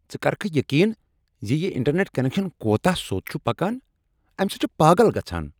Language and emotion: Kashmiri, angry